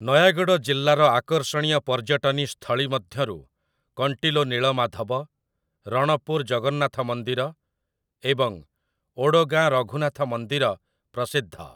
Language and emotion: Odia, neutral